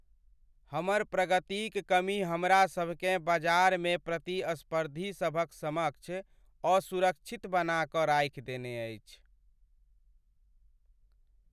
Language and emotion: Maithili, sad